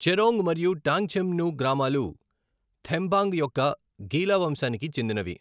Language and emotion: Telugu, neutral